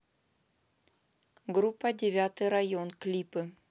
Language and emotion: Russian, neutral